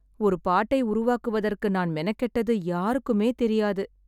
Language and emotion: Tamil, sad